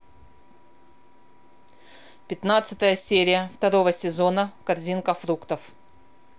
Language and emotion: Russian, neutral